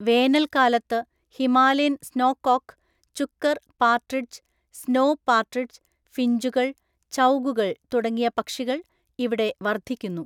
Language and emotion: Malayalam, neutral